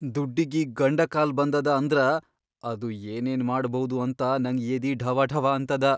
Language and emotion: Kannada, fearful